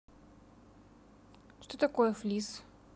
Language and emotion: Russian, neutral